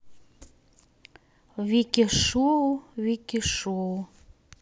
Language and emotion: Russian, neutral